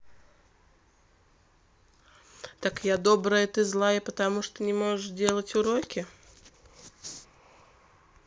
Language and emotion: Russian, neutral